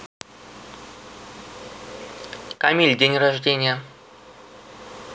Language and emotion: Russian, neutral